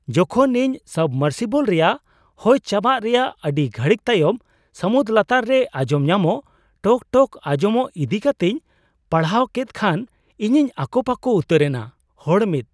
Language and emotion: Santali, surprised